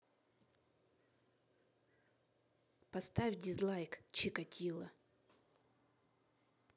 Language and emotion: Russian, neutral